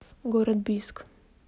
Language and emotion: Russian, neutral